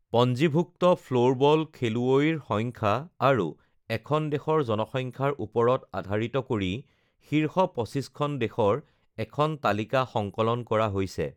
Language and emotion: Assamese, neutral